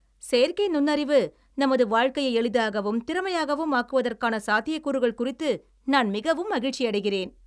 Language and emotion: Tamil, happy